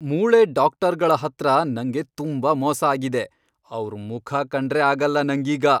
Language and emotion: Kannada, angry